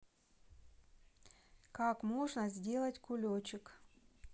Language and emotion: Russian, neutral